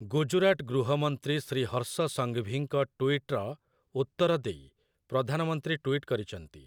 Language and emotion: Odia, neutral